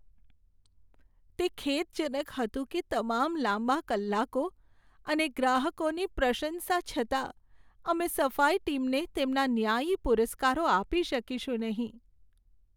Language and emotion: Gujarati, sad